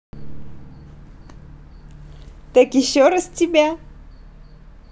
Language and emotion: Russian, positive